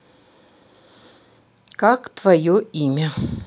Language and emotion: Russian, neutral